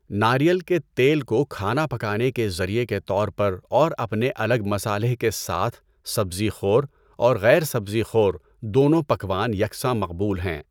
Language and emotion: Urdu, neutral